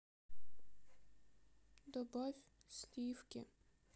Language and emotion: Russian, sad